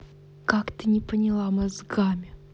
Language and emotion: Russian, angry